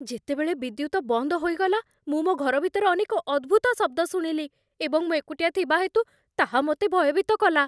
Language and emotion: Odia, fearful